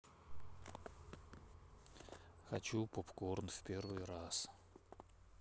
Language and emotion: Russian, neutral